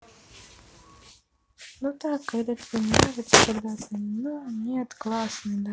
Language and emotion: Russian, sad